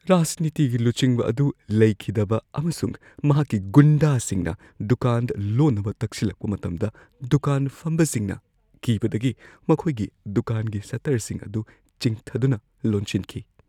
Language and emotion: Manipuri, fearful